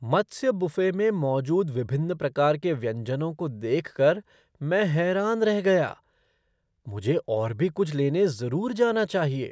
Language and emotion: Hindi, surprised